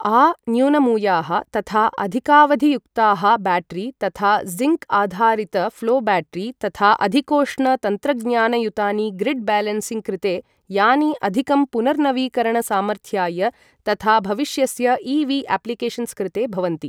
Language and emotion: Sanskrit, neutral